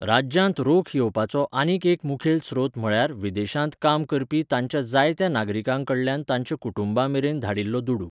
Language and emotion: Goan Konkani, neutral